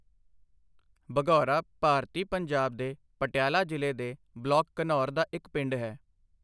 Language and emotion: Punjabi, neutral